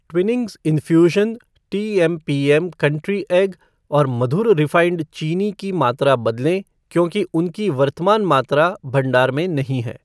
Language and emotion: Hindi, neutral